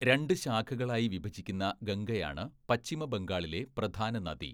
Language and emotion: Malayalam, neutral